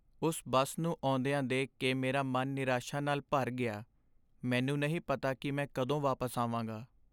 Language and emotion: Punjabi, sad